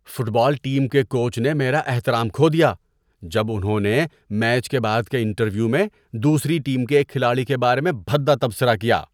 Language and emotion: Urdu, disgusted